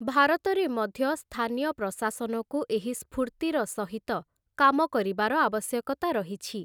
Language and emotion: Odia, neutral